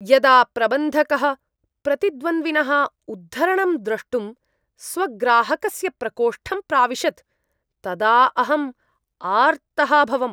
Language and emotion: Sanskrit, disgusted